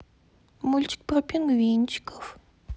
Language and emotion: Russian, neutral